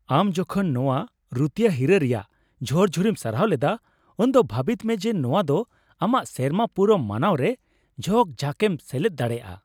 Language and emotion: Santali, happy